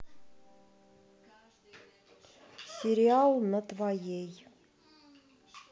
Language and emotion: Russian, neutral